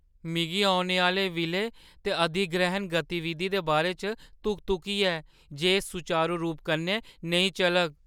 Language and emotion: Dogri, fearful